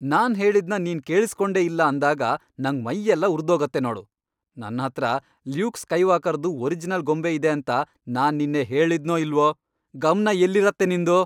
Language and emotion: Kannada, angry